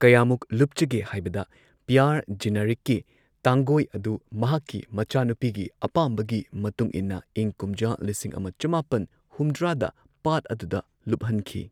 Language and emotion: Manipuri, neutral